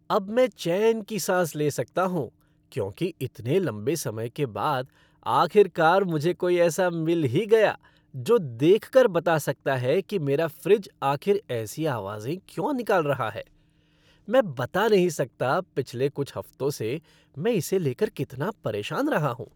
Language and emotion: Hindi, happy